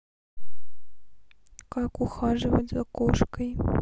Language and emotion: Russian, sad